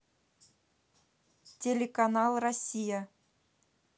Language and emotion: Russian, neutral